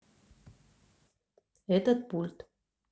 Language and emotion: Russian, neutral